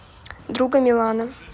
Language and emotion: Russian, neutral